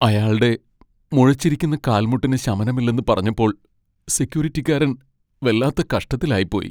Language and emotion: Malayalam, sad